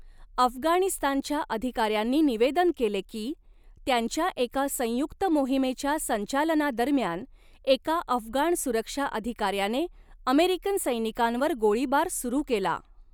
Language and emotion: Marathi, neutral